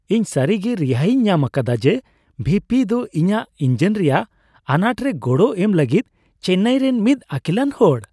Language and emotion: Santali, happy